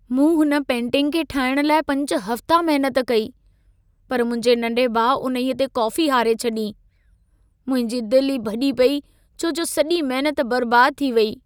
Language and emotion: Sindhi, sad